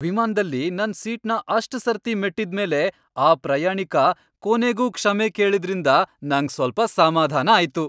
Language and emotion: Kannada, happy